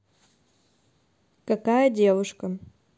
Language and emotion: Russian, neutral